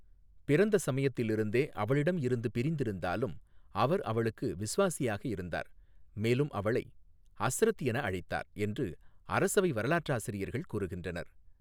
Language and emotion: Tamil, neutral